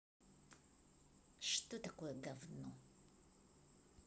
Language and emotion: Russian, angry